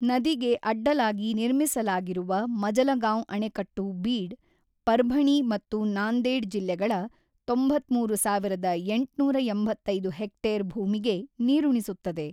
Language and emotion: Kannada, neutral